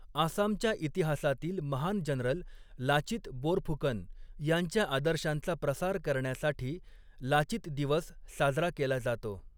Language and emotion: Marathi, neutral